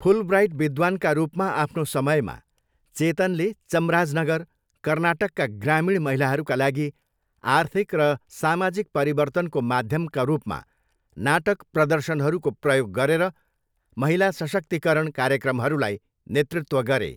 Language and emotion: Nepali, neutral